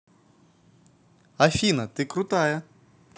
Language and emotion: Russian, positive